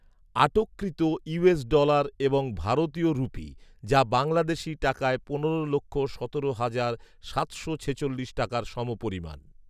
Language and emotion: Bengali, neutral